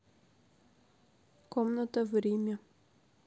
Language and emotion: Russian, neutral